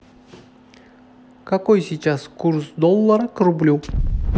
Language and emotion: Russian, neutral